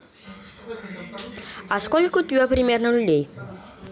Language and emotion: Russian, neutral